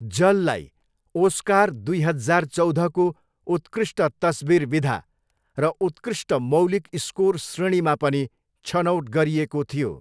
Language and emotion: Nepali, neutral